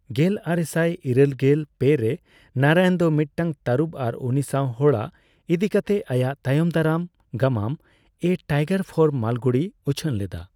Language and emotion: Santali, neutral